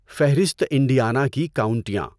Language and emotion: Urdu, neutral